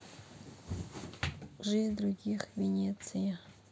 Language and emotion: Russian, neutral